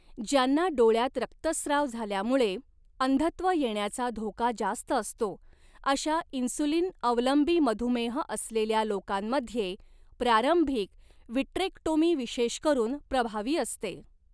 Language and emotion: Marathi, neutral